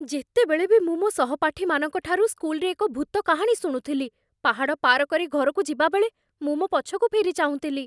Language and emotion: Odia, fearful